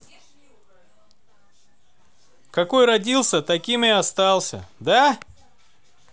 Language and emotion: Russian, neutral